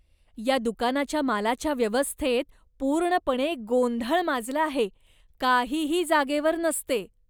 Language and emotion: Marathi, disgusted